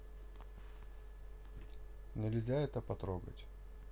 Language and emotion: Russian, neutral